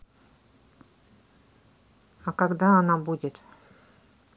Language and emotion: Russian, neutral